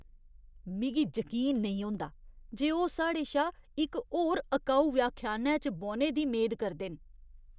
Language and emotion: Dogri, disgusted